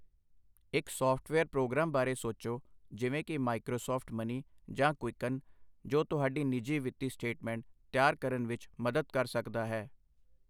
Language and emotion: Punjabi, neutral